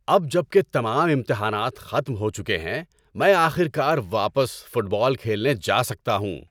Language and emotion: Urdu, happy